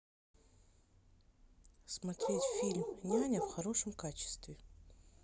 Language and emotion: Russian, neutral